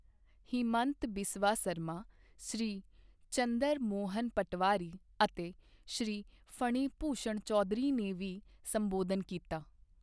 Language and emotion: Punjabi, neutral